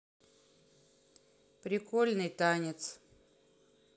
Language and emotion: Russian, neutral